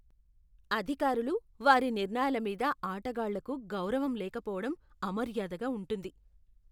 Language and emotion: Telugu, disgusted